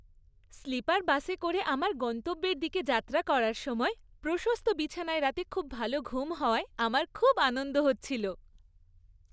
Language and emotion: Bengali, happy